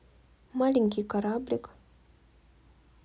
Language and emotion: Russian, neutral